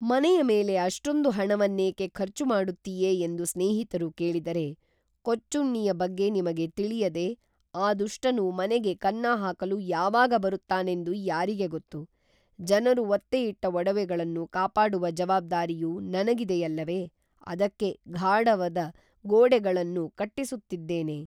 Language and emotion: Kannada, neutral